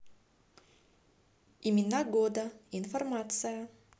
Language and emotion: Russian, positive